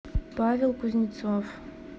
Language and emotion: Russian, neutral